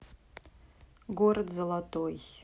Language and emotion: Russian, neutral